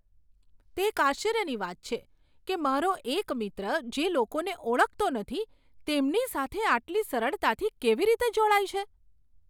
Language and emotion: Gujarati, surprised